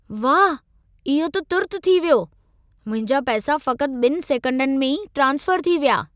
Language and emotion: Sindhi, surprised